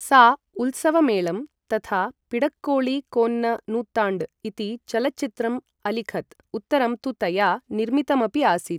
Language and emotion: Sanskrit, neutral